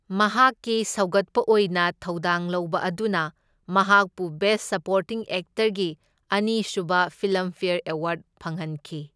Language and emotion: Manipuri, neutral